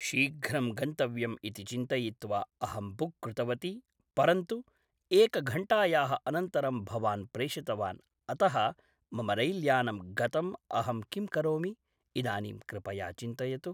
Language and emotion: Sanskrit, neutral